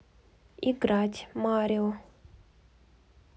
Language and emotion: Russian, neutral